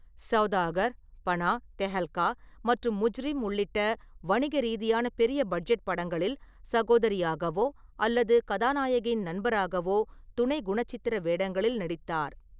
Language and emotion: Tamil, neutral